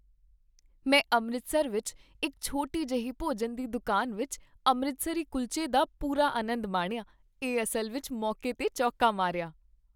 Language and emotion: Punjabi, happy